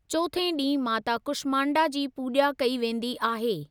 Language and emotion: Sindhi, neutral